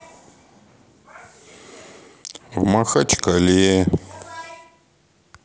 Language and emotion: Russian, sad